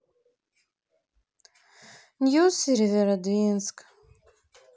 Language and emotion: Russian, sad